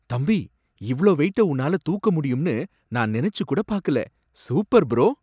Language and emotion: Tamil, surprised